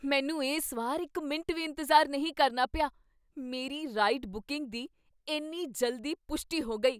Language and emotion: Punjabi, surprised